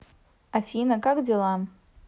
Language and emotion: Russian, neutral